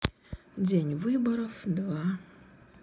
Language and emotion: Russian, sad